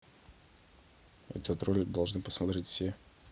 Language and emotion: Russian, neutral